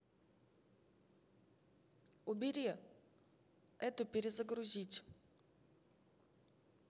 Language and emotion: Russian, neutral